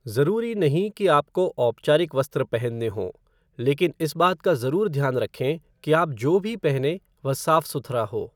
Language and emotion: Hindi, neutral